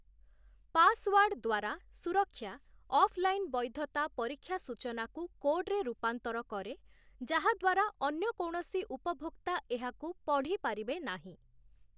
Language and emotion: Odia, neutral